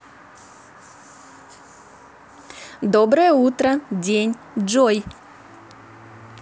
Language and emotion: Russian, positive